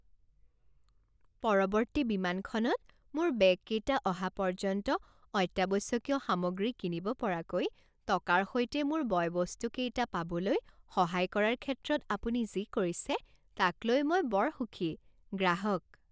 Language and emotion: Assamese, happy